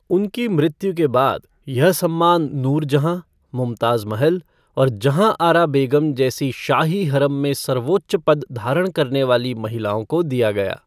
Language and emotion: Hindi, neutral